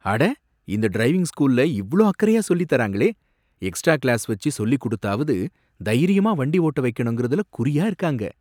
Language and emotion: Tamil, surprised